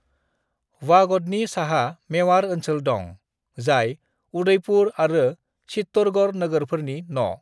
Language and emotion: Bodo, neutral